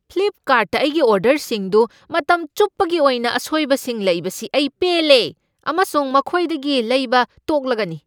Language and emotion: Manipuri, angry